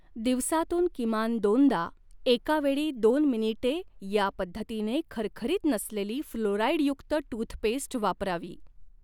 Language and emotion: Marathi, neutral